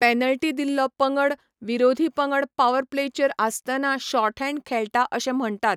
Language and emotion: Goan Konkani, neutral